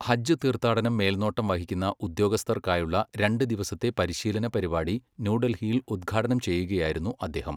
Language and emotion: Malayalam, neutral